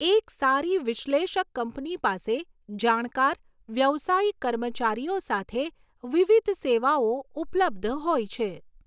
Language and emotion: Gujarati, neutral